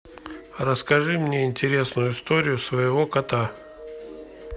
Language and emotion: Russian, neutral